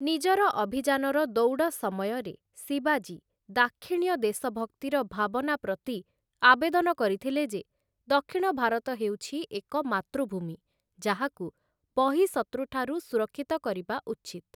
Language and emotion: Odia, neutral